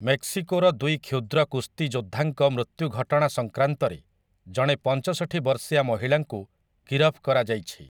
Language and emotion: Odia, neutral